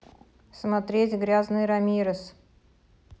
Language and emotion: Russian, neutral